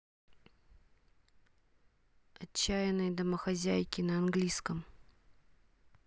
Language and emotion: Russian, neutral